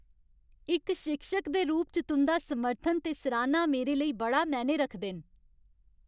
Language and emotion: Dogri, happy